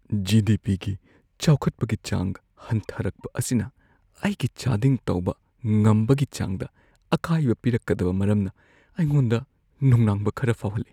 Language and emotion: Manipuri, fearful